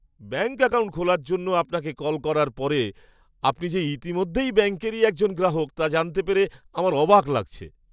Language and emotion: Bengali, surprised